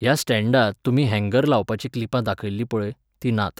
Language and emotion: Goan Konkani, neutral